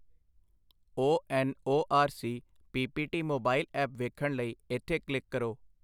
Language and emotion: Punjabi, neutral